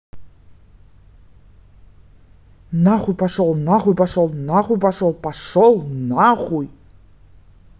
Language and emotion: Russian, angry